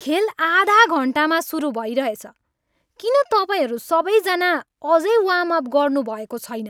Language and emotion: Nepali, angry